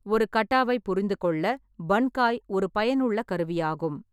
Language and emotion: Tamil, neutral